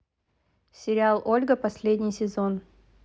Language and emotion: Russian, neutral